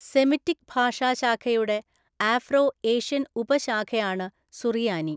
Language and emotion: Malayalam, neutral